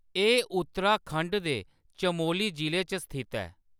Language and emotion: Dogri, neutral